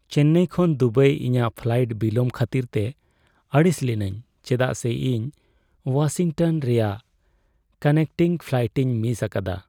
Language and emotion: Santali, sad